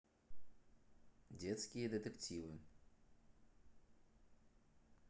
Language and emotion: Russian, neutral